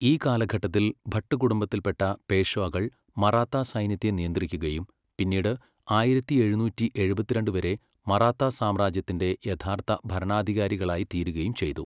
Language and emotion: Malayalam, neutral